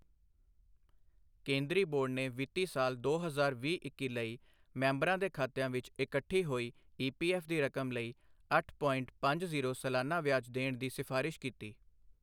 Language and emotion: Punjabi, neutral